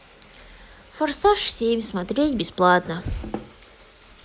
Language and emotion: Russian, sad